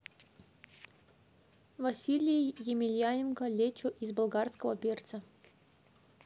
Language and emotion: Russian, neutral